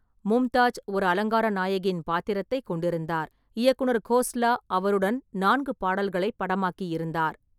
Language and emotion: Tamil, neutral